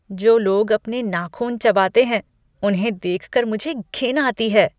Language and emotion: Hindi, disgusted